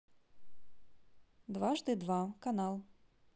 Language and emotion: Russian, neutral